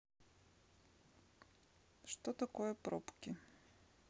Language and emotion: Russian, neutral